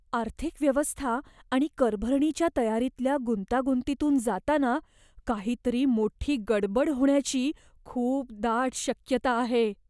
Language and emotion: Marathi, fearful